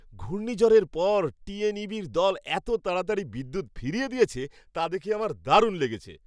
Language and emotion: Bengali, happy